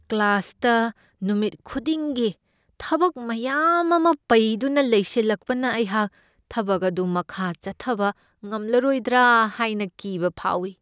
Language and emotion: Manipuri, fearful